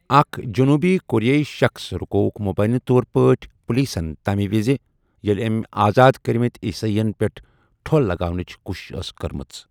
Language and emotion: Kashmiri, neutral